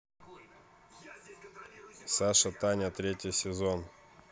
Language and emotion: Russian, neutral